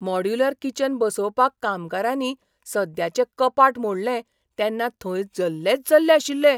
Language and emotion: Goan Konkani, surprised